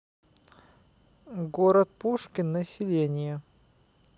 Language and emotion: Russian, neutral